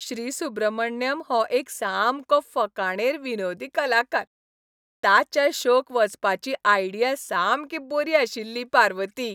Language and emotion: Goan Konkani, happy